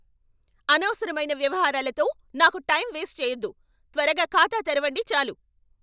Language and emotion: Telugu, angry